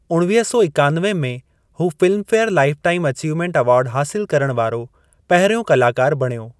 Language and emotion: Sindhi, neutral